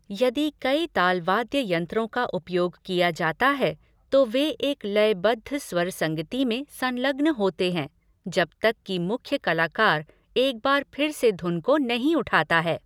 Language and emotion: Hindi, neutral